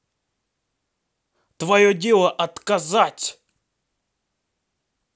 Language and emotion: Russian, angry